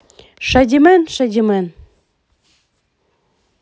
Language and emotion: Russian, positive